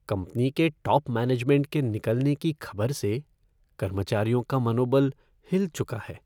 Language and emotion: Hindi, sad